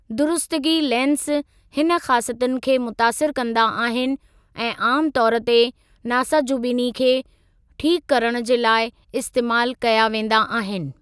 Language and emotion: Sindhi, neutral